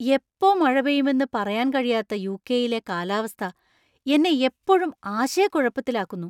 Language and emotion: Malayalam, surprised